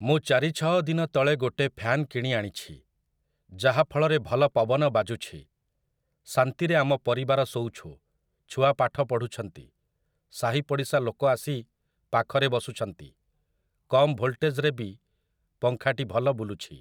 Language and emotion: Odia, neutral